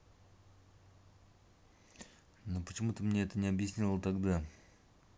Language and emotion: Russian, angry